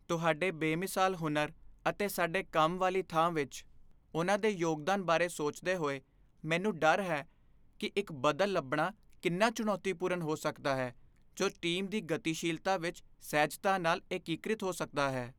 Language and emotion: Punjabi, fearful